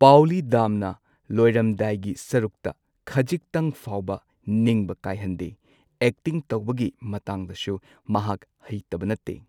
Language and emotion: Manipuri, neutral